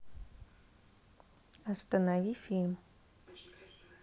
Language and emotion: Russian, neutral